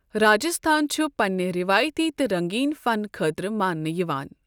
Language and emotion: Kashmiri, neutral